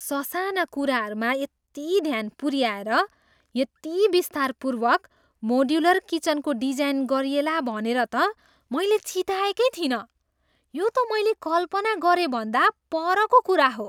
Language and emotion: Nepali, surprised